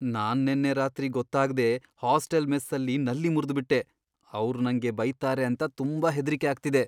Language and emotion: Kannada, fearful